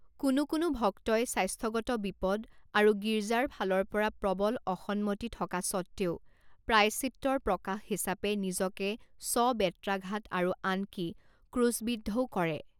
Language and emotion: Assamese, neutral